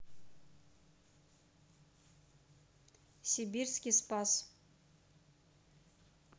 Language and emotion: Russian, neutral